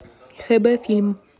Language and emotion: Russian, neutral